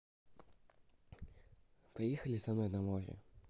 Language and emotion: Russian, neutral